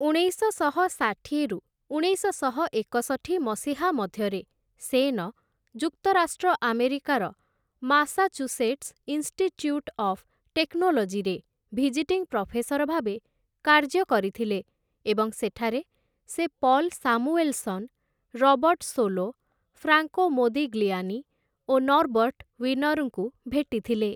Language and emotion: Odia, neutral